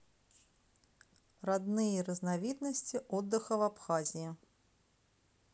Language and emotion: Russian, neutral